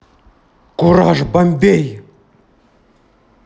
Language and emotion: Russian, angry